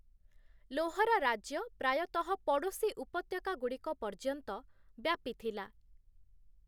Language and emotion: Odia, neutral